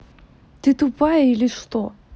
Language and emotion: Russian, angry